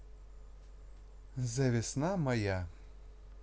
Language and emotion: Russian, neutral